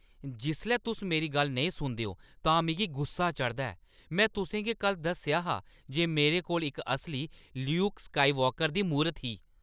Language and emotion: Dogri, angry